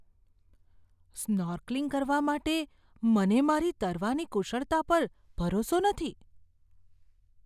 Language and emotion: Gujarati, fearful